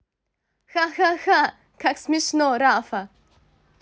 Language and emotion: Russian, positive